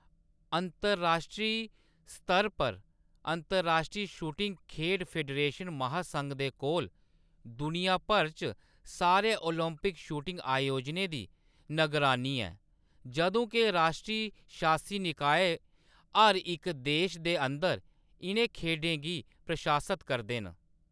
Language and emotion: Dogri, neutral